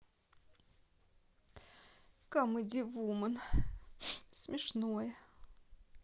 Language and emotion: Russian, sad